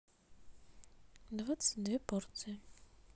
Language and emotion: Russian, neutral